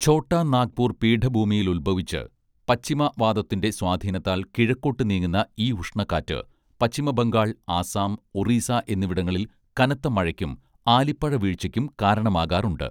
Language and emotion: Malayalam, neutral